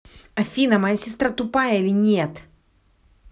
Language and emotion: Russian, angry